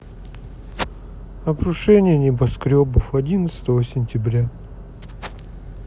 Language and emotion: Russian, sad